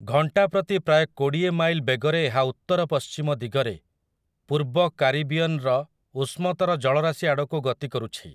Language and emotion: Odia, neutral